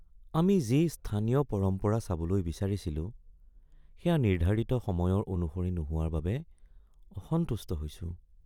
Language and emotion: Assamese, sad